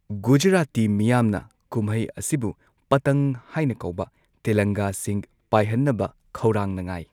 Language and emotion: Manipuri, neutral